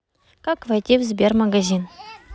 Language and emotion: Russian, neutral